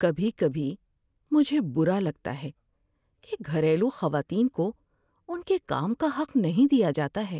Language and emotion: Urdu, sad